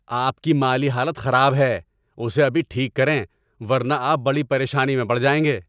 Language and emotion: Urdu, angry